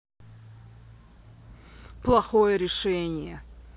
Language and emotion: Russian, angry